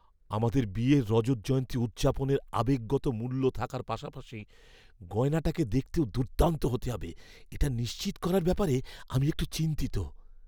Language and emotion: Bengali, fearful